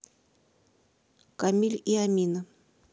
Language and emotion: Russian, neutral